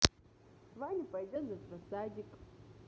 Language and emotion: Russian, positive